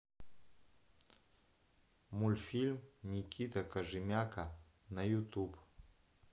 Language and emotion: Russian, neutral